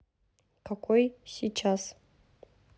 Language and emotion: Russian, neutral